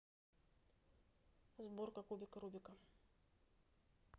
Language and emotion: Russian, neutral